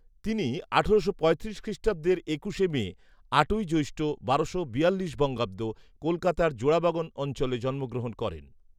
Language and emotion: Bengali, neutral